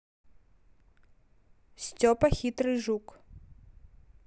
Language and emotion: Russian, neutral